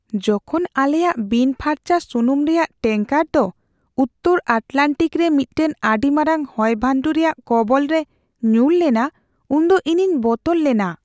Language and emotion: Santali, fearful